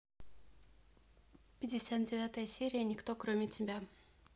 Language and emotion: Russian, neutral